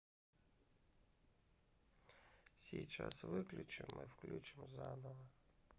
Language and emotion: Russian, neutral